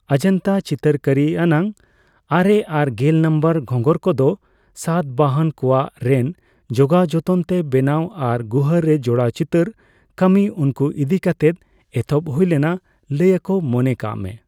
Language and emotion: Santali, neutral